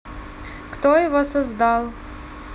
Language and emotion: Russian, neutral